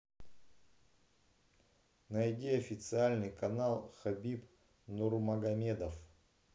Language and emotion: Russian, neutral